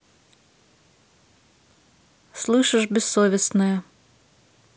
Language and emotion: Russian, neutral